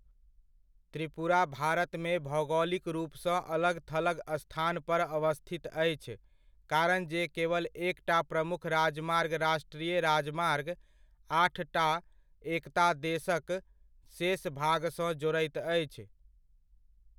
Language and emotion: Maithili, neutral